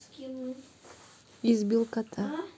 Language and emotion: Russian, neutral